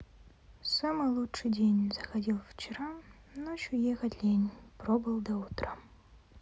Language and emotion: Russian, sad